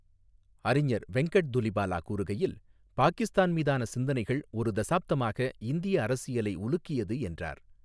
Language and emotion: Tamil, neutral